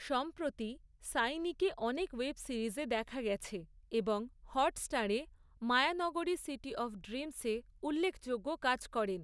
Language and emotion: Bengali, neutral